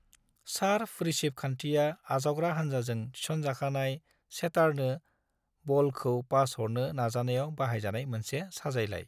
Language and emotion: Bodo, neutral